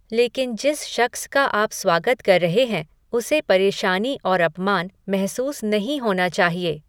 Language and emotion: Hindi, neutral